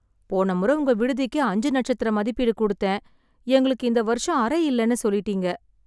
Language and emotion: Tamil, sad